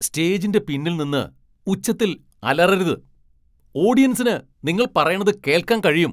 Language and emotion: Malayalam, angry